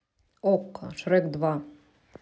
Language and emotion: Russian, neutral